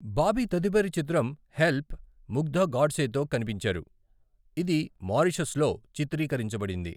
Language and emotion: Telugu, neutral